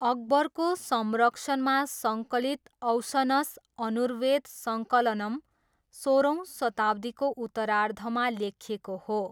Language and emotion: Nepali, neutral